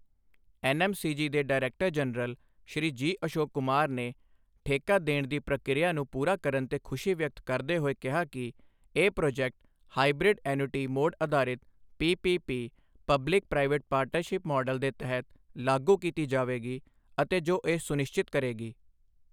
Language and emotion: Punjabi, neutral